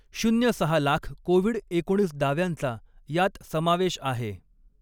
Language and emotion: Marathi, neutral